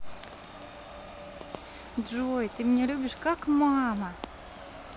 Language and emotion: Russian, positive